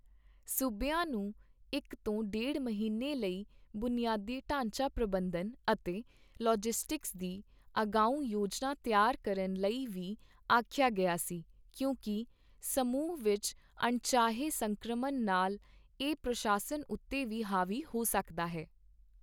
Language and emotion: Punjabi, neutral